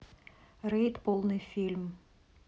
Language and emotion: Russian, neutral